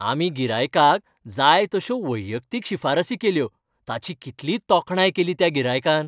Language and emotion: Goan Konkani, happy